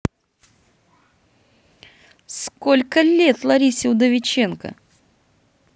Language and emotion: Russian, neutral